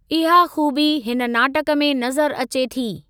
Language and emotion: Sindhi, neutral